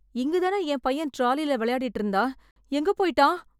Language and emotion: Tamil, fearful